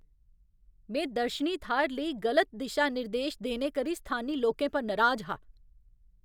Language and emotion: Dogri, angry